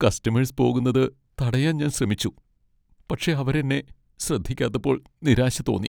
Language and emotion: Malayalam, sad